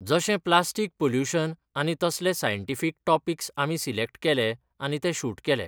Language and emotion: Goan Konkani, neutral